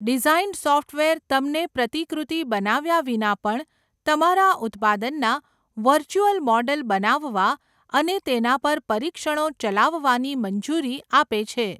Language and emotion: Gujarati, neutral